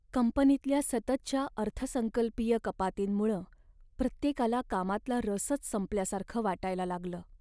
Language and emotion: Marathi, sad